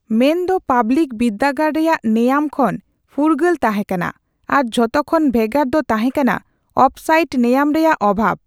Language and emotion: Santali, neutral